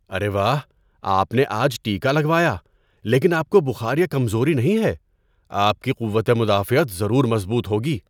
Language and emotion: Urdu, surprised